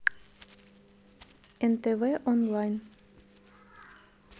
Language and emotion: Russian, neutral